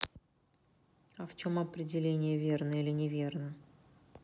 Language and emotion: Russian, neutral